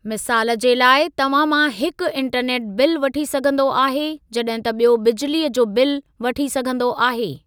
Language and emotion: Sindhi, neutral